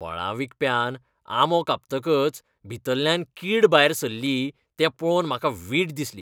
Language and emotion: Goan Konkani, disgusted